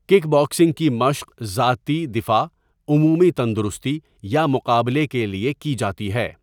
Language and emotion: Urdu, neutral